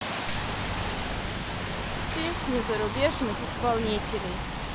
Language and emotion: Russian, neutral